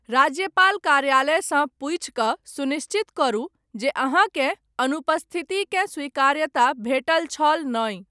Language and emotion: Maithili, neutral